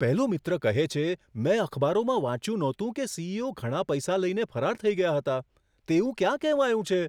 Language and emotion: Gujarati, surprised